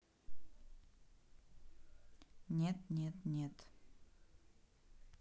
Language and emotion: Russian, neutral